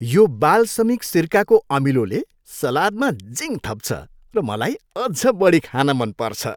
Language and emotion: Nepali, happy